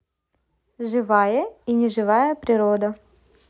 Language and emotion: Russian, neutral